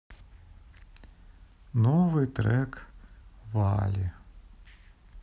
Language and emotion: Russian, sad